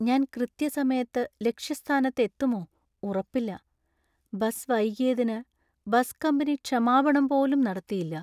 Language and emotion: Malayalam, sad